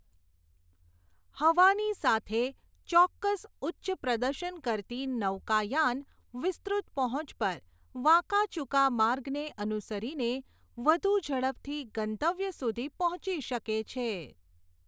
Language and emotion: Gujarati, neutral